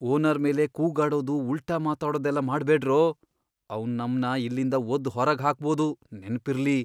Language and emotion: Kannada, fearful